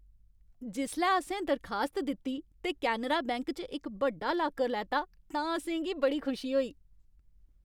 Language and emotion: Dogri, happy